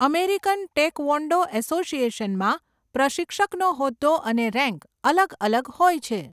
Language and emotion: Gujarati, neutral